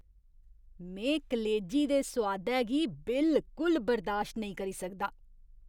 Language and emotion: Dogri, disgusted